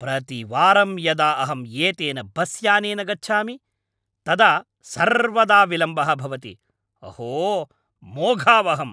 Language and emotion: Sanskrit, angry